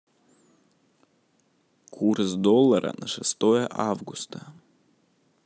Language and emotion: Russian, neutral